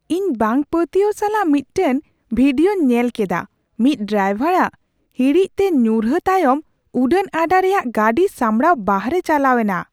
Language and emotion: Santali, surprised